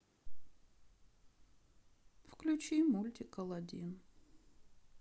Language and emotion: Russian, sad